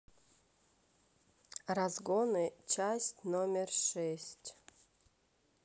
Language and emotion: Russian, neutral